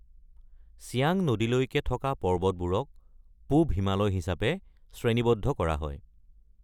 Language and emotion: Assamese, neutral